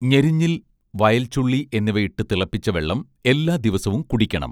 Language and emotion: Malayalam, neutral